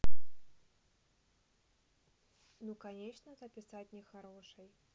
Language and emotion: Russian, neutral